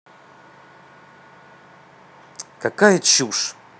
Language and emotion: Russian, angry